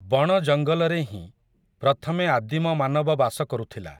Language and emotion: Odia, neutral